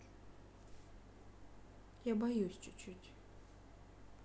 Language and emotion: Russian, sad